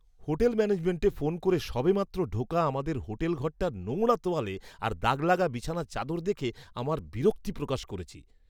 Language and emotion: Bengali, disgusted